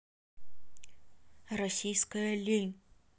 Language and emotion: Russian, neutral